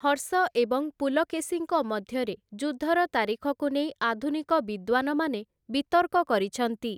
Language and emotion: Odia, neutral